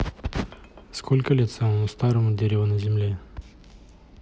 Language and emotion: Russian, neutral